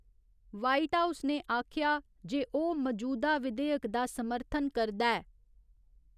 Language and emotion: Dogri, neutral